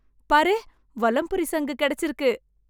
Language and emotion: Tamil, happy